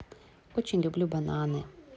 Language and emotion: Russian, positive